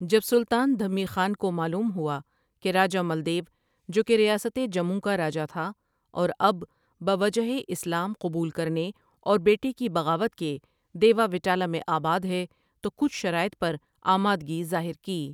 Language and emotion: Urdu, neutral